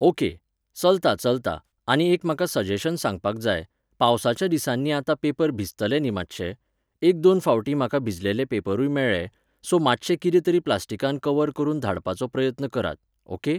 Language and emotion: Goan Konkani, neutral